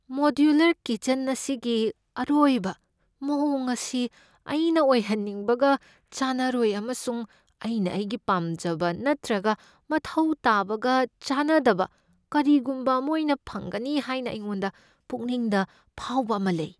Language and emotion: Manipuri, fearful